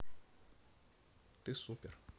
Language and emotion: Russian, neutral